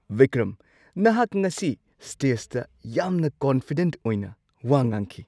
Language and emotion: Manipuri, surprised